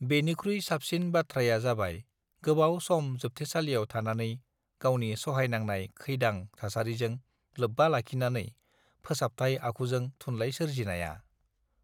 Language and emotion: Bodo, neutral